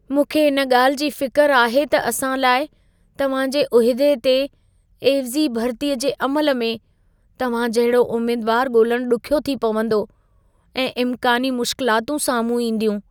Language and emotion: Sindhi, fearful